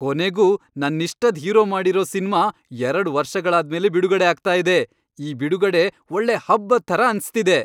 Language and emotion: Kannada, happy